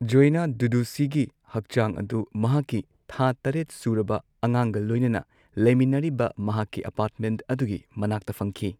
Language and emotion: Manipuri, neutral